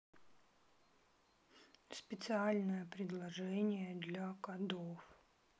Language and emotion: Russian, neutral